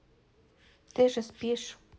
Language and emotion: Russian, neutral